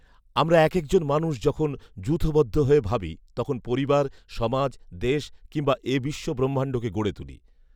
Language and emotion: Bengali, neutral